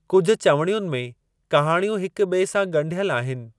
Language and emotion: Sindhi, neutral